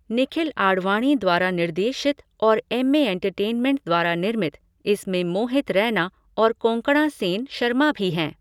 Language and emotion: Hindi, neutral